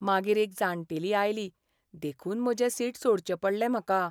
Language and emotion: Goan Konkani, sad